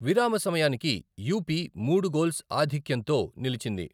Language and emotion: Telugu, neutral